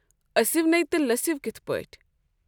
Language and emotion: Kashmiri, neutral